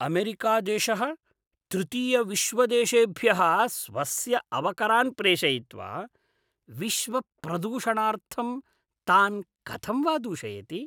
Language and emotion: Sanskrit, disgusted